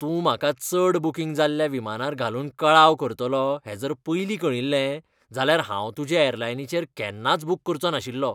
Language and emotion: Goan Konkani, disgusted